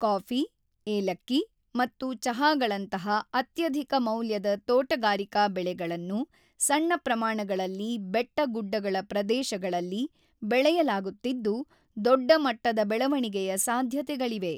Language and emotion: Kannada, neutral